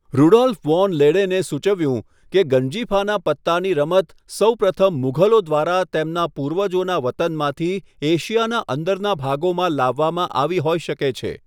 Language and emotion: Gujarati, neutral